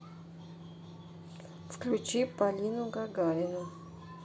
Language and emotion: Russian, neutral